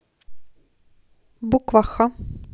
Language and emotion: Russian, neutral